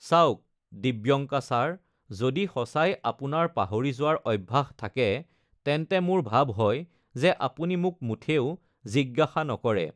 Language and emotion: Assamese, neutral